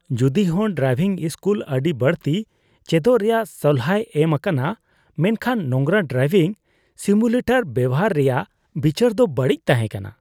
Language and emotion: Santali, disgusted